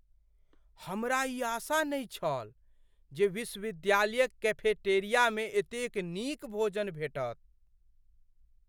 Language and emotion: Maithili, surprised